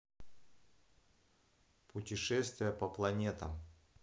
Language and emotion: Russian, neutral